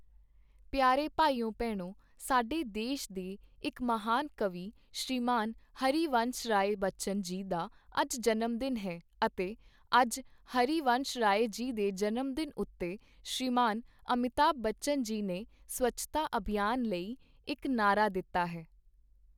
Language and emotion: Punjabi, neutral